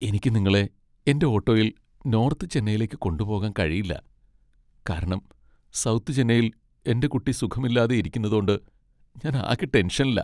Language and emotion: Malayalam, sad